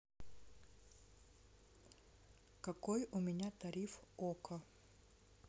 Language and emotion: Russian, neutral